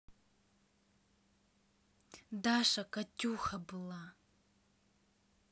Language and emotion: Russian, neutral